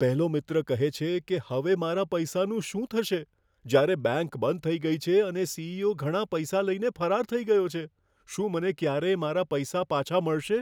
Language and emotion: Gujarati, fearful